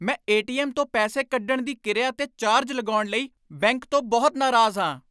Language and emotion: Punjabi, angry